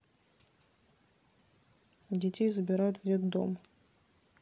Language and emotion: Russian, neutral